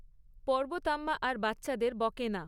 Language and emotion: Bengali, neutral